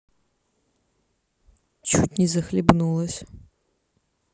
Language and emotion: Russian, neutral